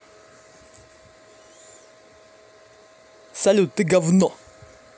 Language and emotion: Russian, angry